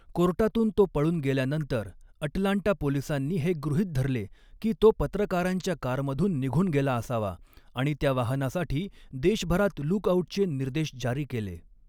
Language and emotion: Marathi, neutral